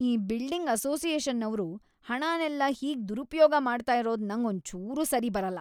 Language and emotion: Kannada, angry